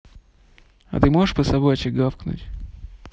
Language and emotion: Russian, neutral